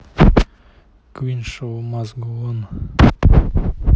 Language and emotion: Russian, neutral